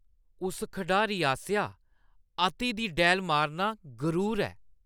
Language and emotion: Dogri, disgusted